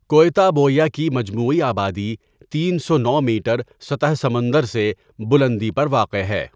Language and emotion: Urdu, neutral